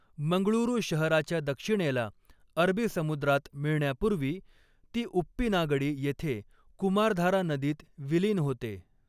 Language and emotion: Marathi, neutral